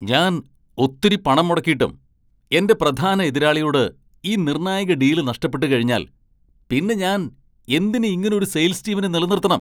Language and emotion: Malayalam, angry